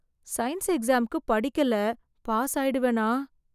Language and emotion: Tamil, fearful